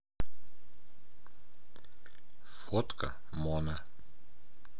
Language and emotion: Russian, neutral